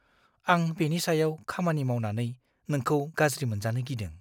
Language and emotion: Bodo, fearful